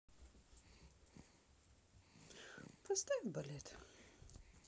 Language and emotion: Russian, sad